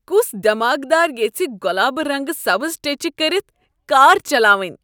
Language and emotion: Kashmiri, disgusted